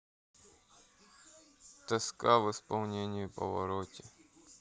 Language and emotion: Russian, sad